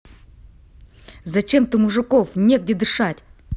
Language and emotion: Russian, angry